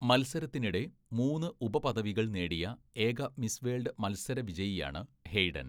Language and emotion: Malayalam, neutral